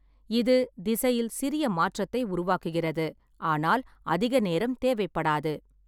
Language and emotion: Tamil, neutral